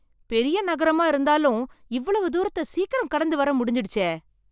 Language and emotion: Tamil, surprised